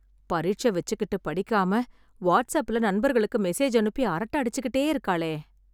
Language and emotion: Tamil, sad